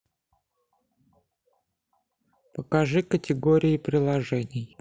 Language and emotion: Russian, neutral